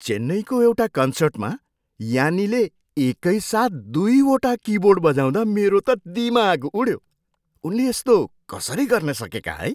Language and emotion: Nepali, surprised